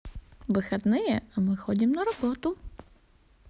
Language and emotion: Russian, positive